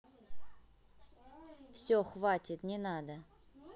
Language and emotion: Russian, angry